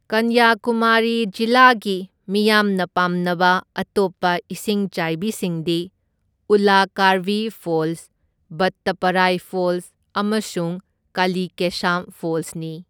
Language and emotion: Manipuri, neutral